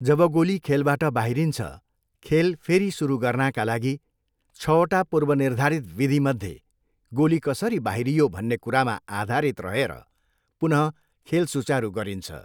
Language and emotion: Nepali, neutral